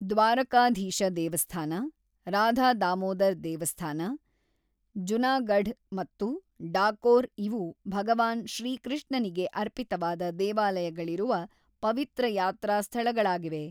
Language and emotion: Kannada, neutral